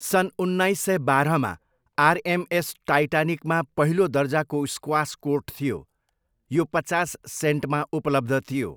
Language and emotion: Nepali, neutral